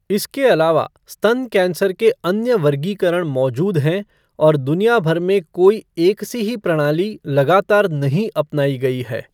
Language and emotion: Hindi, neutral